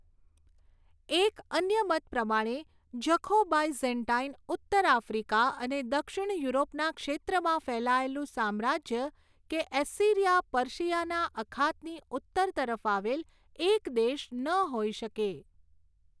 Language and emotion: Gujarati, neutral